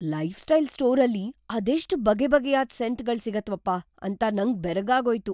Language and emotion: Kannada, surprised